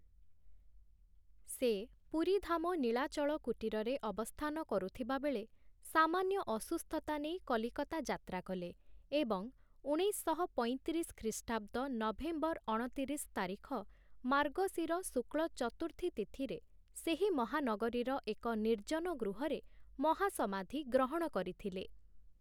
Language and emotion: Odia, neutral